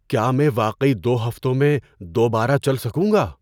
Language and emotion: Urdu, surprised